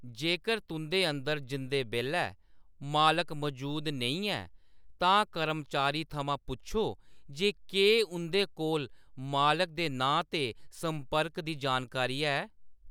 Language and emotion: Dogri, neutral